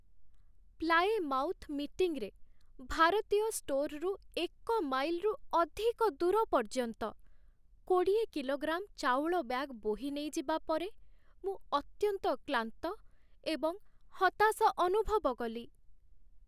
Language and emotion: Odia, sad